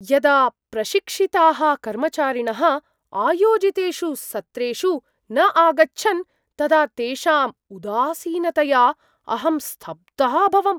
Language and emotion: Sanskrit, surprised